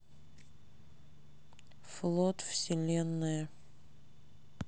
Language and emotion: Russian, neutral